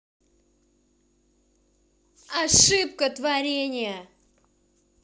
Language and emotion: Russian, angry